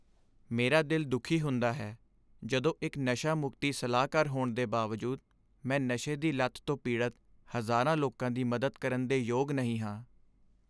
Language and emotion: Punjabi, sad